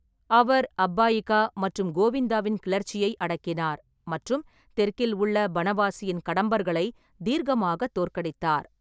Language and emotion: Tamil, neutral